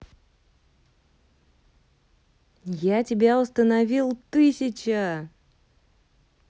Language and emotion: Russian, positive